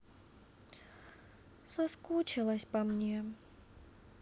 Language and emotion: Russian, sad